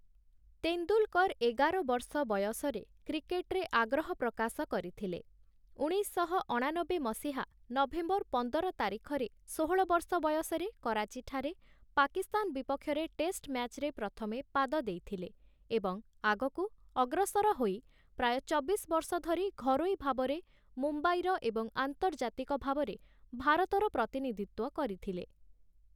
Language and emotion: Odia, neutral